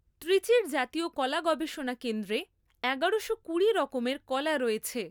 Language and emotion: Bengali, neutral